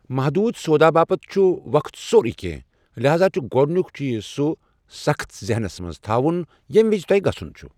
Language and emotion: Kashmiri, neutral